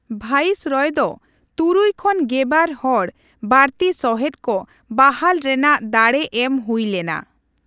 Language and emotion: Santali, neutral